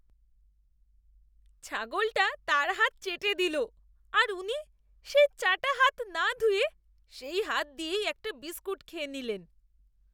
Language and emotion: Bengali, disgusted